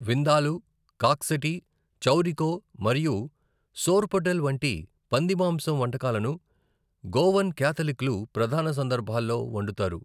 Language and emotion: Telugu, neutral